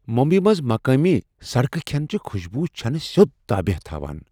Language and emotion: Kashmiri, surprised